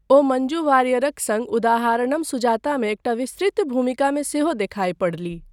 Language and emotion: Maithili, neutral